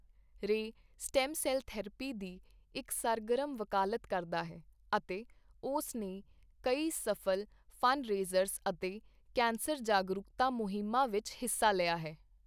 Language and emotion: Punjabi, neutral